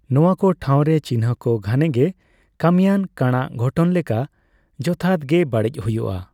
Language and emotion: Santali, neutral